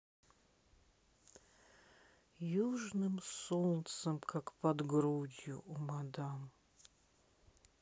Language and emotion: Russian, neutral